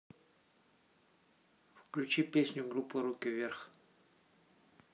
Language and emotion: Russian, neutral